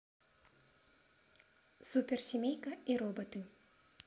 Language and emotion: Russian, neutral